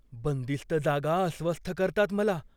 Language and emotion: Marathi, fearful